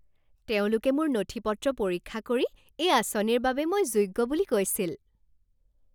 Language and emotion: Assamese, happy